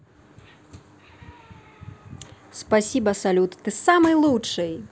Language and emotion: Russian, positive